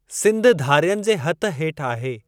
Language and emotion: Sindhi, neutral